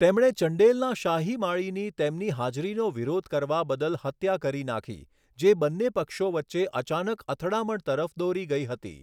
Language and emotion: Gujarati, neutral